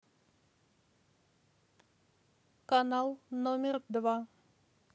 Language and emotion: Russian, neutral